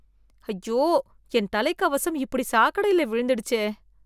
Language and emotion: Tamil, disgusted